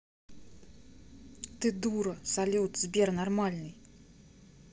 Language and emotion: Russian, angry